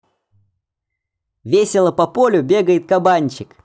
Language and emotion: Russian, positive